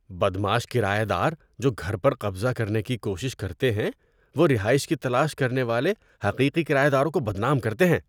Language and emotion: Urdu, disgusted